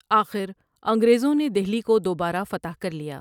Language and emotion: Urdu, neutral